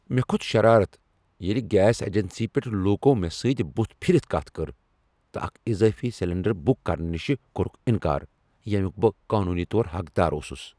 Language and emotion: Kashmiri, angry